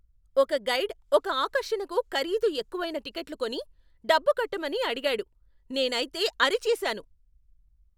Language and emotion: Telugu, angry